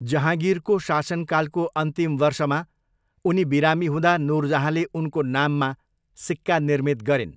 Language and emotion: Nepali, neutral